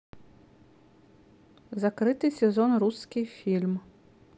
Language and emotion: Russian, neutral